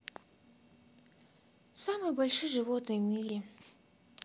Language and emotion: Russian, sad